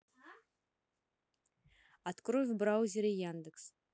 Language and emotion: Russian, neutral